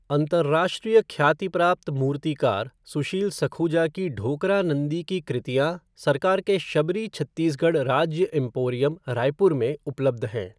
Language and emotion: Hindi, neutral